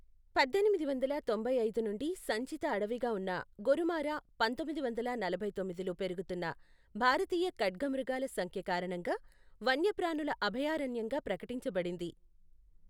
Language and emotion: Telugu, neutral